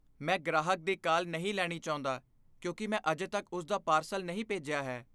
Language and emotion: Punjabi, fearful